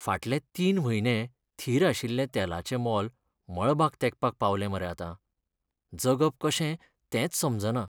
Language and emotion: Goan Konkani, sad